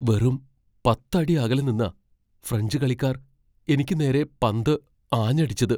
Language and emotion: Malayalam, fearful